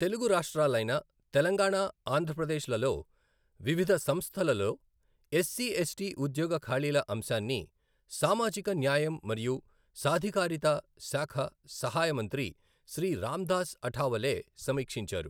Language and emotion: Telugu, neutral